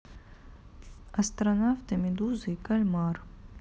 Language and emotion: Russian, neutral